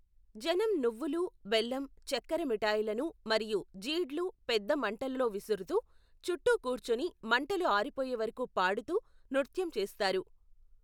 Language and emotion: Telugu, neutral